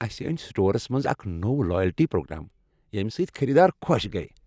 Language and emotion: Kashmiri, happy